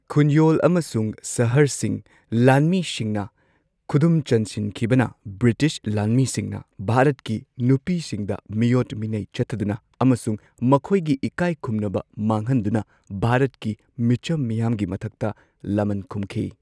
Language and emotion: Manipuri, neutral